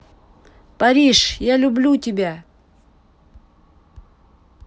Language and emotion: Russian, positive